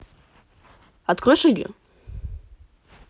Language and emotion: Russian, neutral